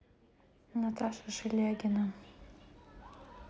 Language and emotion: Russian, sad